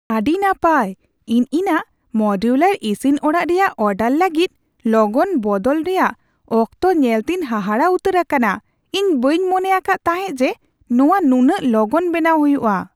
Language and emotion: Santali, surprised